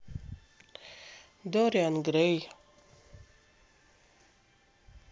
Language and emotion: Russian, sad